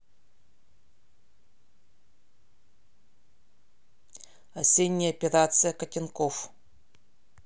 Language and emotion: Russian, neutral